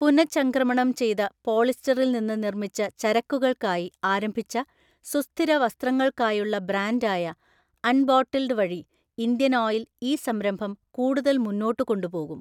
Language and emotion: Malayalam, neutral